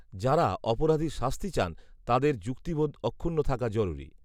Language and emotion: Bengali, neutral